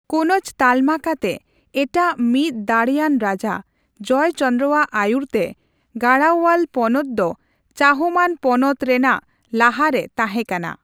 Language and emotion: Santali, neutral